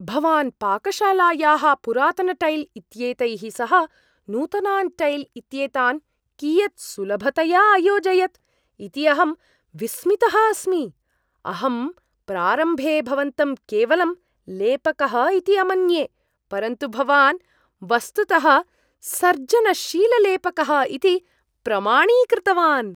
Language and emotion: Sanskrit, surprised